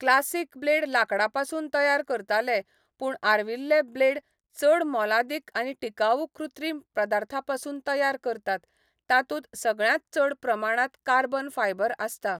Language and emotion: Goan Konkani, neutral